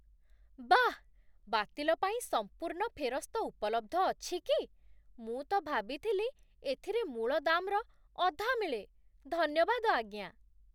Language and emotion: Odia, surprised